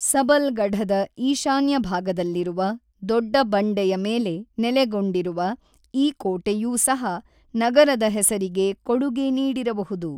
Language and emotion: Kannada, neutral